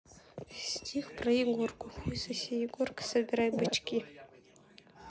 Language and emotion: Russian, neutral